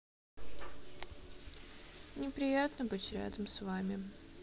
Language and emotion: Russian, sad